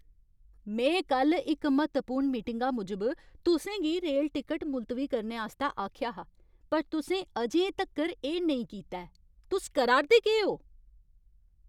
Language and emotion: Dogri, angry